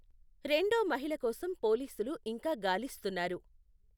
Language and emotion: Telugu, neutral